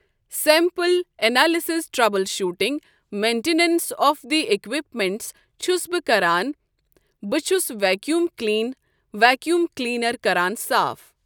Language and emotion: Kashmiri, neutral